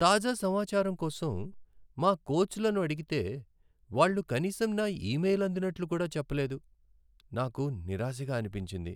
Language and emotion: Telugu, sad